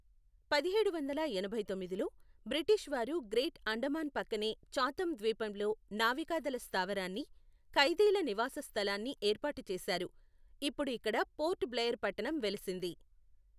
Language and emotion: Telugu, neutral